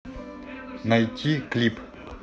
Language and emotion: Russian, neutral